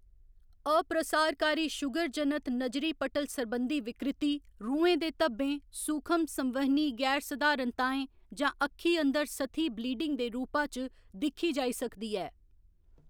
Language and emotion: Dogri, neutral